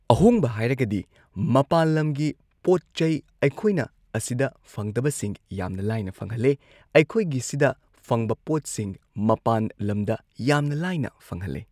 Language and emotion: Manipuri, neutral